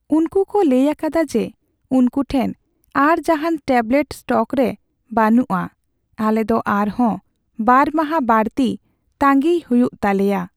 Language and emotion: Santali, sad